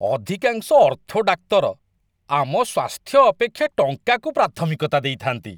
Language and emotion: Odia, disgusted